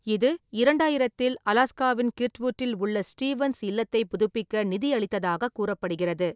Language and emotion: Tamil, neutral